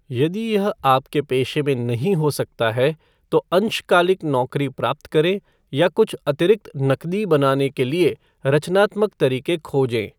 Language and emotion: Hindi, neutral